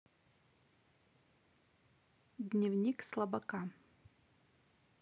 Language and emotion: Russian, neutral